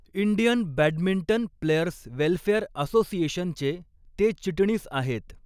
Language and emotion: Marathi, neutral